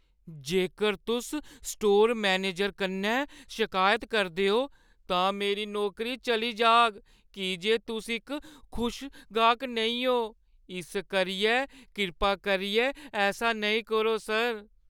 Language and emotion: Dogri, fearful